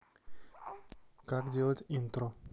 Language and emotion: Russian, neutral